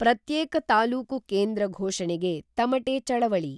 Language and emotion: Kannada, neutral